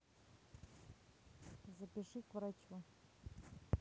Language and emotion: Russian, neutral